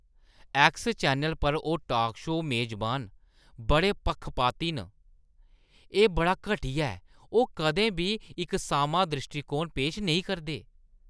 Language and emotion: Dogri, disgusted